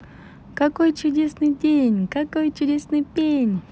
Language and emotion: Russian, positive